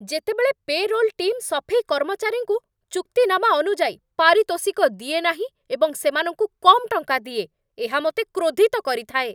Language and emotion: Odia, angry